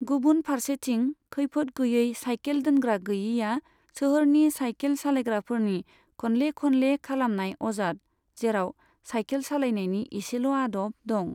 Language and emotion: Bodo, neutral